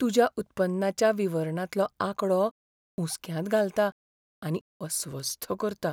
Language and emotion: Goan Konkani, fearful